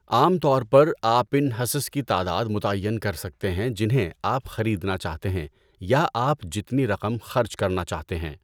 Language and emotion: Urdu, neutral